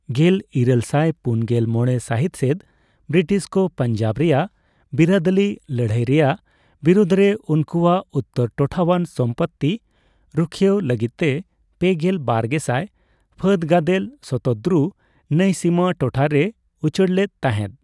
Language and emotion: Santali, neutral